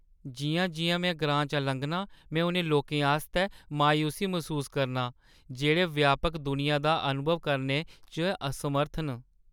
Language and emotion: Dogri, sad